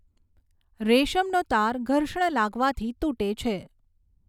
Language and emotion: Gujarati, neutral